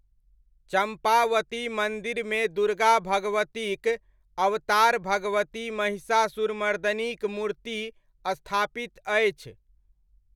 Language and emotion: Maithili, neutral